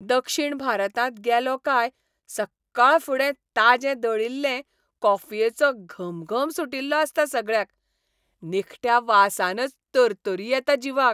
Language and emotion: Goan Konkani, happy